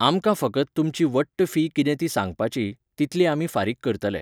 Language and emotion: Goan Konkani, neutral